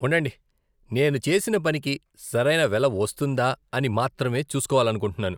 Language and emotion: Telugu, disgusted